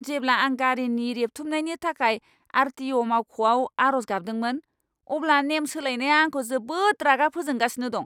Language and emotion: Bodo, angry